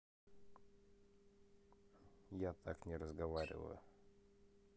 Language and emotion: Russian, neutral